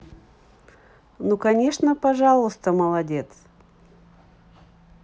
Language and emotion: Russian, positive